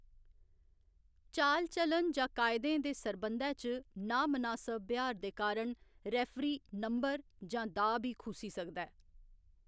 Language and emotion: Dogri, neutral